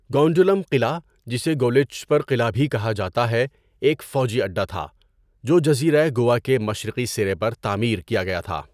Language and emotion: Urdu, neutral